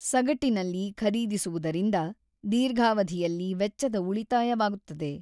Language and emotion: Kannada, neutral